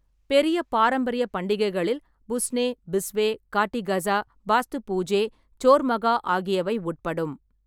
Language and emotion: Tamil, neutral